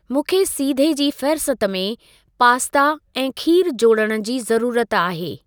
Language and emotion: Sindhi, neutral